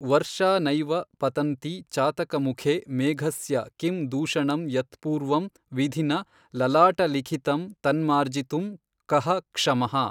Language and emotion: Kannada, neutral